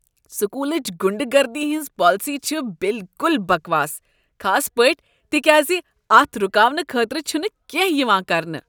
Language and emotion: Kashmiri, disgusted